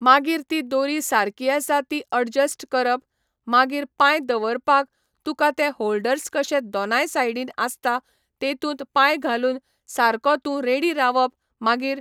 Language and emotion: Goan Konkani, neutral